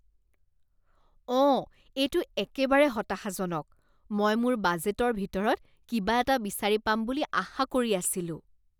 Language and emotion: Assamese, disgusted